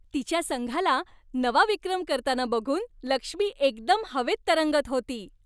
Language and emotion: Marathi, happy